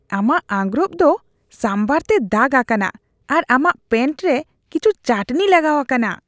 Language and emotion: Santali, disgusted